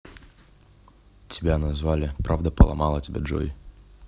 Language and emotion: Russian, neutral